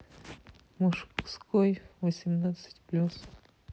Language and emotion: Russian, neutral